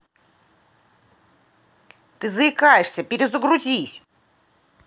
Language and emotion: Russian, angry